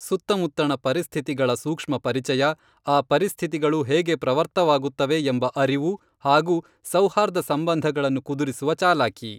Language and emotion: Kannada, neutral